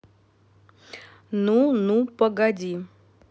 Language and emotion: Russian, neutral